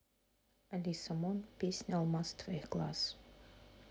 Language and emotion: Russian, neutral